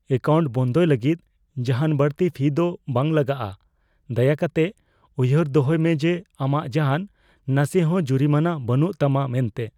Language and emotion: Santali, fearful